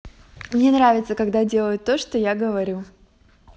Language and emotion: Russian, positive